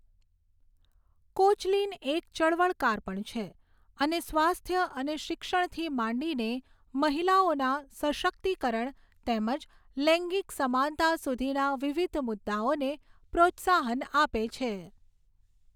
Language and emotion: Gujarati, neutral